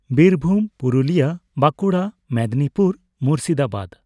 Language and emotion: Santali, neutral